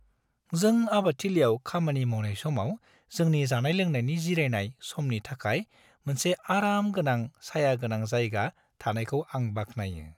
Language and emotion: Bodo, happy